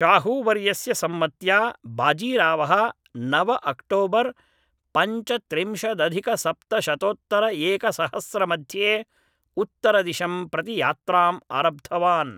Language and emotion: Sanskrit, neutral